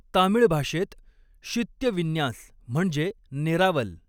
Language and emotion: Marathi, neutral